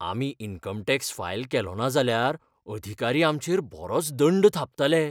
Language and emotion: Goan Konkani, fearful